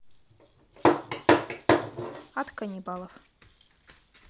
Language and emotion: Russian, neutral